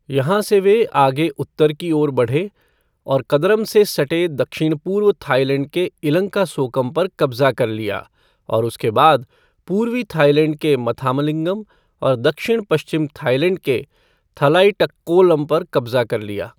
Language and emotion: Hindi, neutral